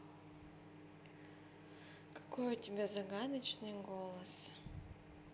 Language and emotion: Russian, neutral